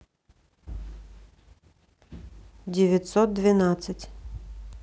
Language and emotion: Russian, neutral